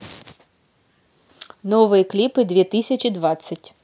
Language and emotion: Russian, positive